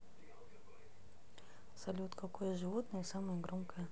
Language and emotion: Russian, neutral